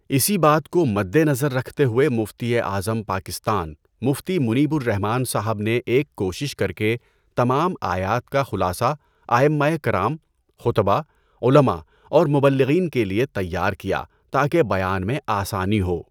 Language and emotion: Urdu, neutral